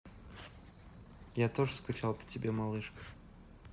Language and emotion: Russian, neutral